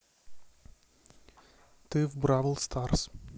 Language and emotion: Russian, neutral